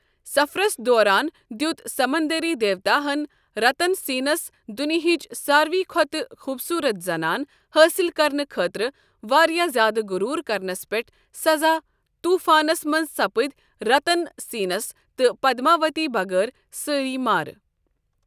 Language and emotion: Kashmiri, neutral